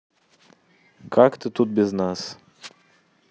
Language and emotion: Russian, neutral